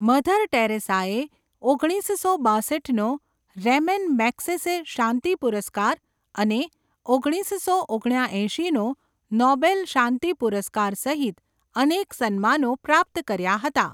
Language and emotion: Gujarati, neutral